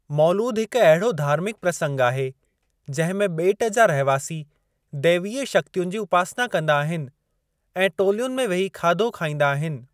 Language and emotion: Sindhi, neutral